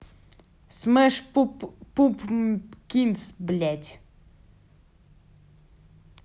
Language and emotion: Russian, angry